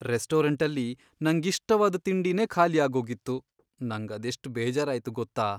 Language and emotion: Kannada, sad